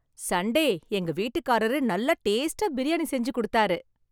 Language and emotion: Tamil, happy